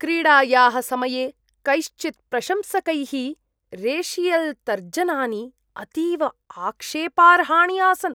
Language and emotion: Sanskrit, disgusted